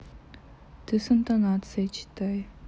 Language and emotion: Russian, neutral